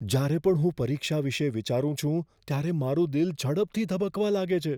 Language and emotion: Gujarati, fearful